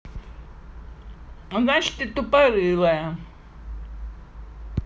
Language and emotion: Russian, angry